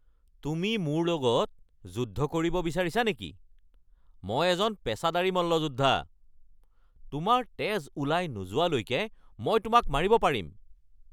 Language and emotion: Assamese, angry